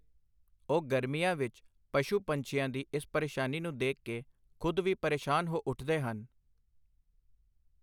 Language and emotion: Punjabi, neutral